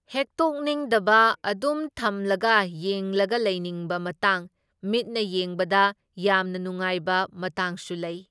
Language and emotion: Manipuri, neutral